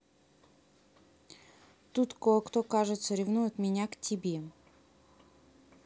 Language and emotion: Russian, neutral